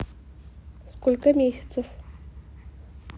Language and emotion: Russian, neutral